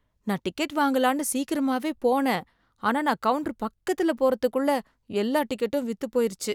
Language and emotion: Tamil, sad